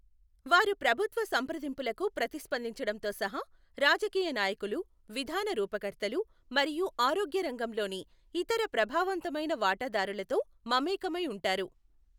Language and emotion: Telugu, neutral